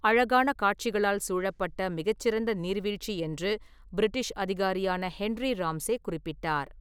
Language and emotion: Tamil, neutral